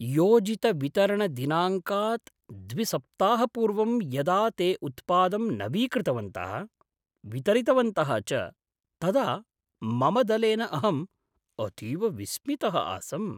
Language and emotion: Sanskrit, surprised